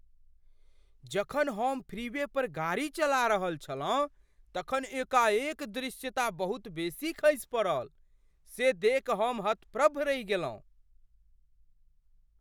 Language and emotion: Maithili, surprised